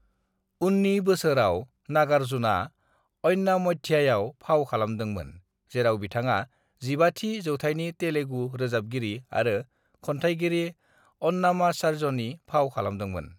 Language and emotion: Bodo, neutral